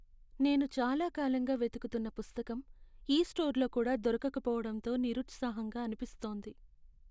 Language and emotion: Telugu, sad